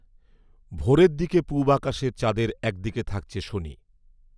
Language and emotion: Bengali, neutral